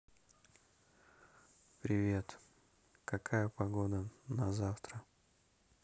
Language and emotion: Russian, neutral